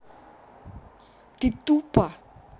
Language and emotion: Russian, angry